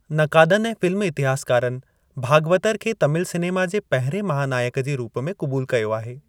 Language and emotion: Sindhi, neutral